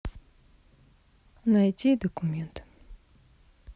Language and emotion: Russian, sad